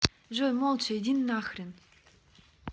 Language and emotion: Russian, angry